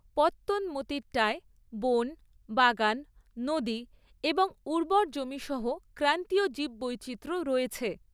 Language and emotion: Bengali, neutral